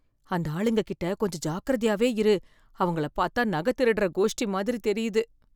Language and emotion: Tamil, fearful